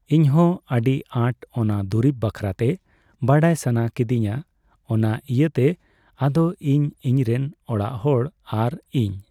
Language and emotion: Santali, neutral